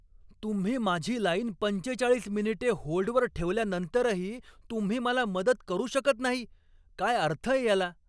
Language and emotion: Marathi, angry